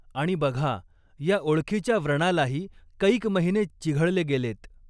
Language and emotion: Marathi, neutral